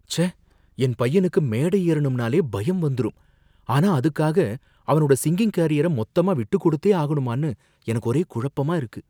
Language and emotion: Tamil, fearful